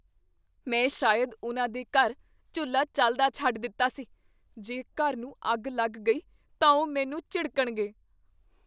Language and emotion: Punjabi, fearful